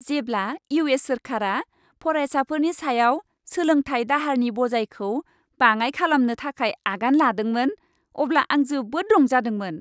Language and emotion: Bodo, happy